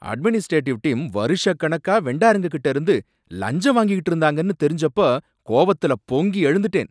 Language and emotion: Tamil, angry